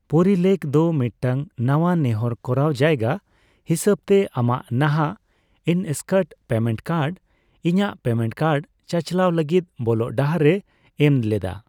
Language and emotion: Santali, neutral